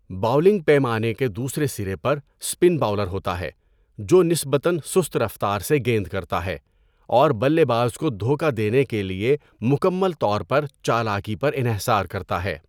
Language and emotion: Urdu, neutral